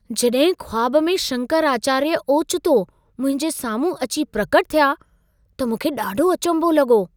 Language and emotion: Sindhi, surprised